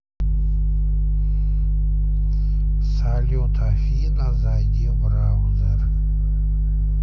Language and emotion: Russian, neutral